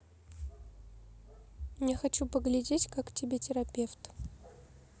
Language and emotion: Russian, neutral